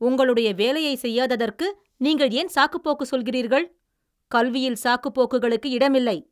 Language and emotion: Tamil, angry